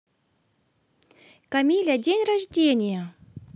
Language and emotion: Russian, positive